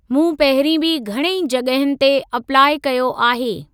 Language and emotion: Sindhi, neutral